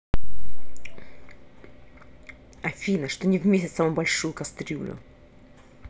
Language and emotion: Russian, angry